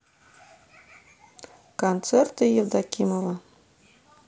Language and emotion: Russian, neutral